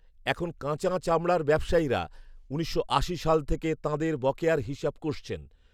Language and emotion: Bengali, neutral